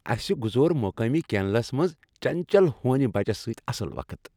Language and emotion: Kashmiri, happy